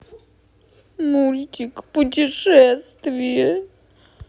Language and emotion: Russian, sad